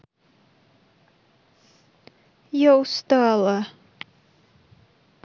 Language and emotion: Russian, sad